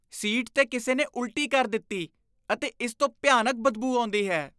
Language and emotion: Punjabi, disgusted